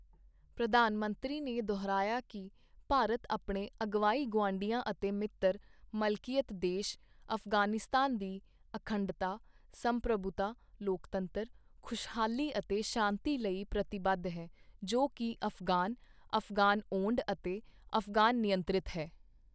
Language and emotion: Punjabi, neutral